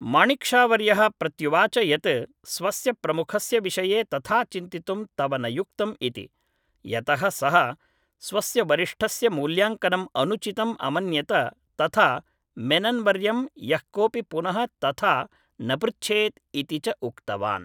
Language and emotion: Sanskrit, neutral